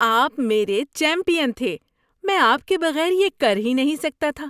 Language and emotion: Urdu, happy